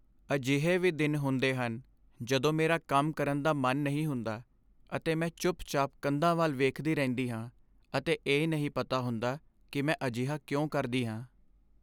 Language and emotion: Punjabi, sad